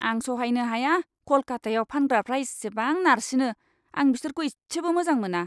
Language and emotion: Bodo, disgusted